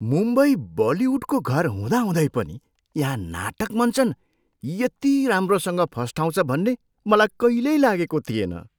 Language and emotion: Nepali, surprised